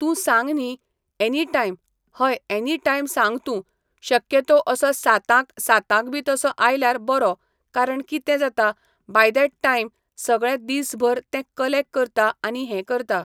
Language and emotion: Goan Konkani, neutral